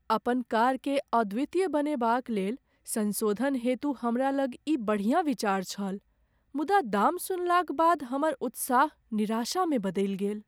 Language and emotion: Maithili, sad